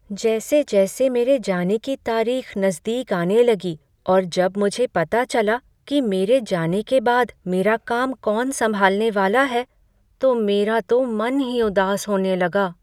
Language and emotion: Hindi, sad